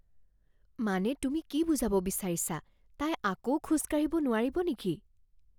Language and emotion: Assamese, fearful